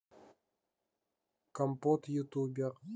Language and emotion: Russian, neutral